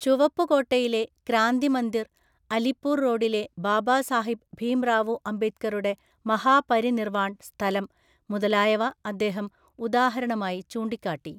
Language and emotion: Malayalam, neutral